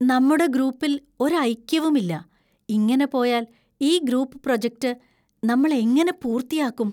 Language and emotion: Malayalam, fearful